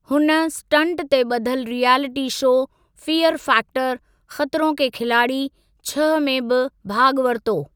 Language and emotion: Sindhi, neutral